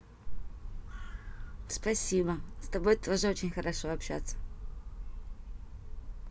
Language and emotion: Russian, positive